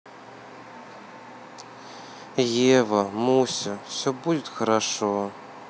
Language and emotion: Russian, sad